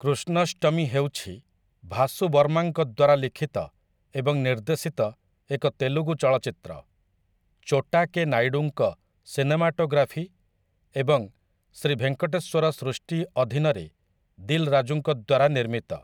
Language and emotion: Odia, neutral